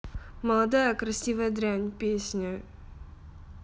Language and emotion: Russian, sad